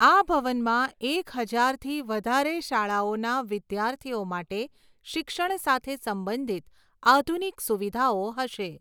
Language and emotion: Gujarati, neutral